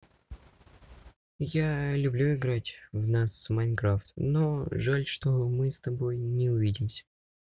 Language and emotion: Russian, neutral